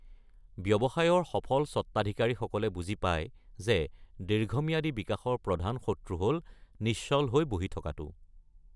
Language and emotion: Assamese, neutral